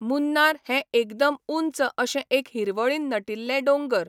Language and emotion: Goan Konkani, neutral